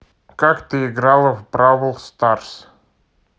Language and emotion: Russian, neutral